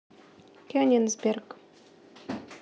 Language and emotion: Russian, neutral